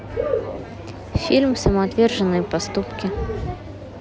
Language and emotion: Russian, neutral